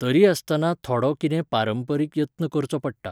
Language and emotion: Goan Konkani, neutral